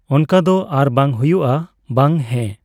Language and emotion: Santali, neutral